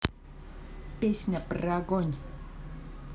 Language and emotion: Russian, positive